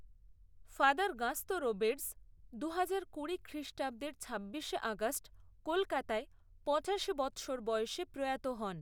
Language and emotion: Bengali, neutral